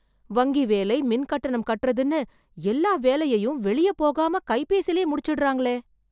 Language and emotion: Tamil, surprised